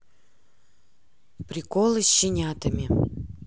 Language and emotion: Russian, neutral